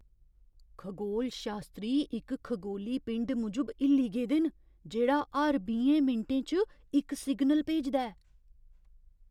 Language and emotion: Dogri, surprised